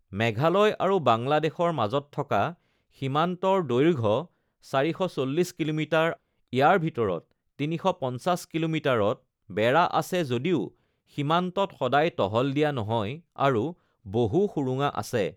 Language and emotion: Assamese, neutral